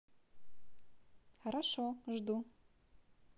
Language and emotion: Russian, positive